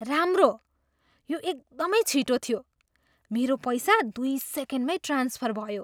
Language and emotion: Nepali, surprised